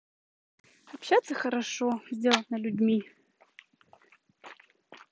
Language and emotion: Russian, positive